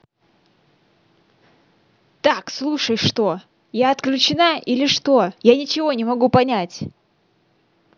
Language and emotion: Russian, angry